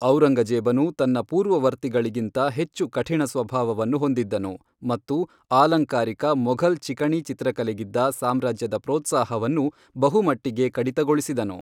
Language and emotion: Kannada, neutral